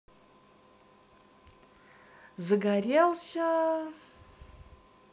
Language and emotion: Russian, positive